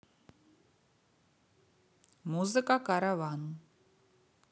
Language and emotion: Russian, neutral